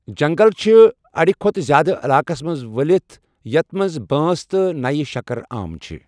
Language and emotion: Kashmiri, neutral